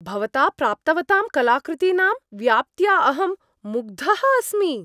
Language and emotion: Sanskrit, happy